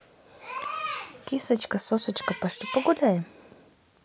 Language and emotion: Russian, positive